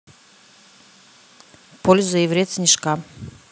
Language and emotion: Russian, neutral